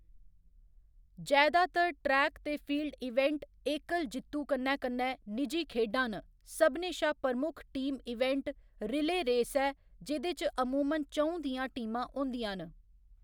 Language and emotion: Dogri, neutral